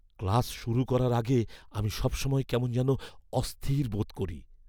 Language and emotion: Bengali, fearful